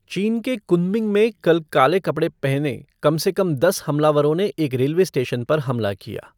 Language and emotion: Hindi, neutral